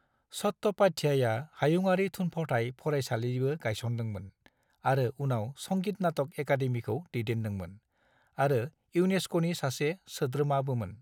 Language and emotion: Bodo, neutral